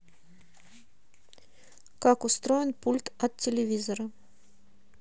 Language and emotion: Russian, neutral